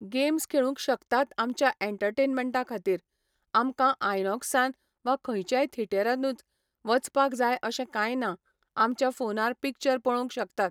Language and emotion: Goan Konkani, neutral